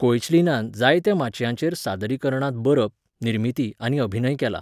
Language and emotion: Goan Konkani, neutral